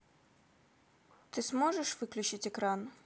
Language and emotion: Russian, neutral